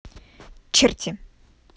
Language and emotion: Russian, angry